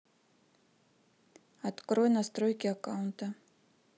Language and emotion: Russian, neutral